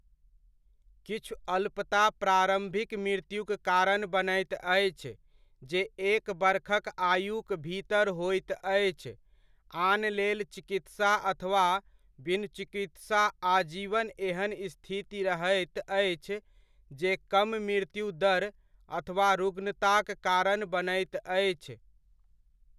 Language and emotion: Maithili, neutral